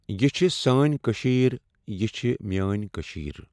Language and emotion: Kashmiri, neutral